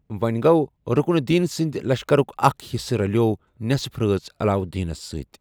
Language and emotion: Kashmiri, neutral